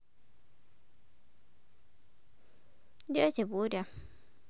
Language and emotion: Russian, neutral